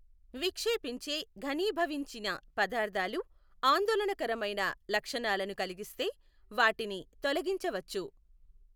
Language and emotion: Telugu, neutral